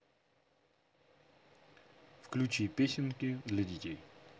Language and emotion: Russian, neutral